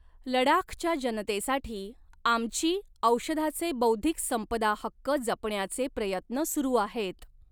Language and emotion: Marathi, neutral